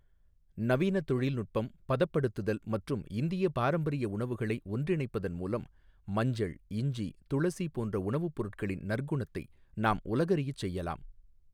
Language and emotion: Tamil, neutral